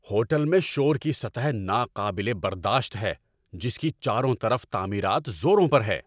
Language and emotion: Urdu, angry